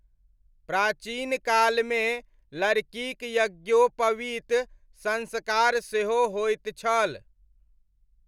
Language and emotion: Maithili, neutral